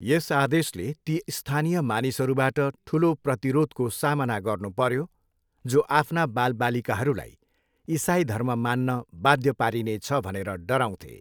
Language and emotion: Nepali, neutral